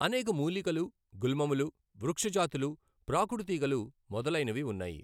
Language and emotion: Telugu, neutral